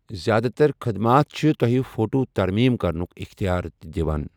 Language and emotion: Kashmiri, neutral